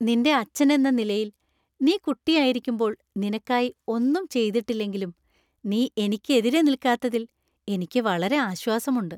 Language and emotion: Malayalam, happy